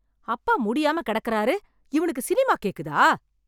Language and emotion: Tamil, angry